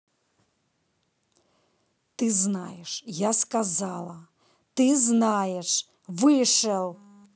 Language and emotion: Russian, angry